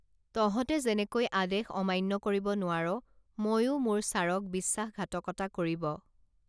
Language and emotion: Assamese, neutral